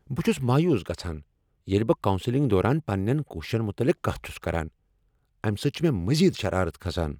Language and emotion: Kashmiri, angry